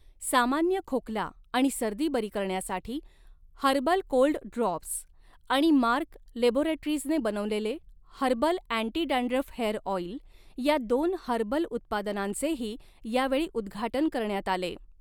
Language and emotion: Marathi, neutral